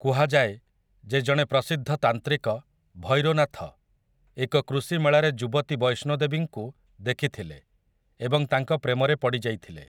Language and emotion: Odia, neutral